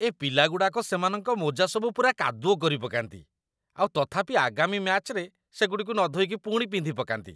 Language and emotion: Odia, disgusted